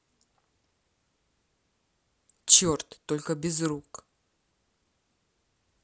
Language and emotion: Russian, neutral